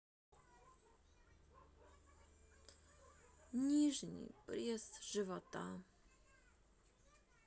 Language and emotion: Russian, sad